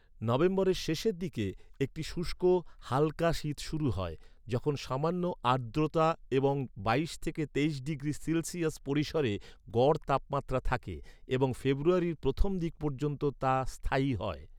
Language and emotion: Bengali, neutral